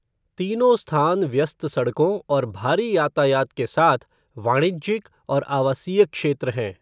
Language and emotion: Hindi, neutral